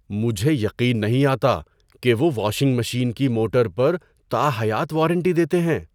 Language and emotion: Urdu, surprised